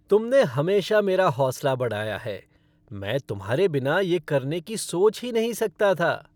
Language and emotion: Hindi, happy